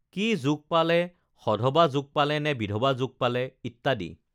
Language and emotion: Assamese, neutral